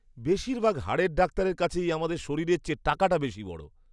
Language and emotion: Bengali, disgusted